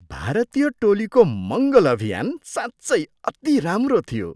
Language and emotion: Nepali, surprised